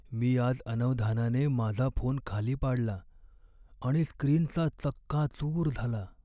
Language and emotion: Marathi, sad